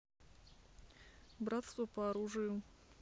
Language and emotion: Russian, neutral